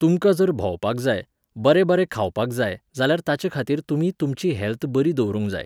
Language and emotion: Goan Konkani, neutral